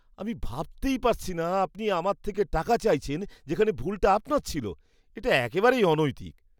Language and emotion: Bengali, disgusted